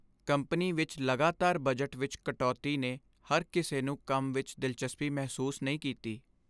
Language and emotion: Punjabi, sad